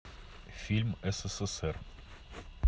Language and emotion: Russian, neutral